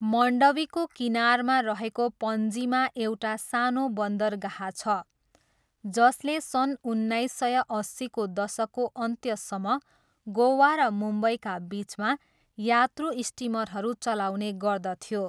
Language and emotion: Nepali, neutral